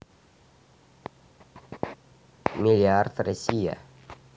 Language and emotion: Russian, neutral